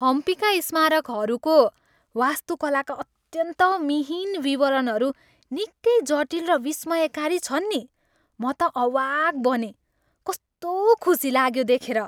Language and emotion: Nepali, happy